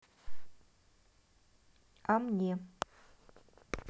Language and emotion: Russian, neutral